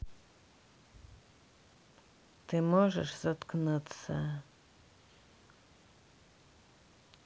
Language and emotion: Russian, neutral